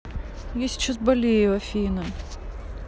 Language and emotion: Russian, sad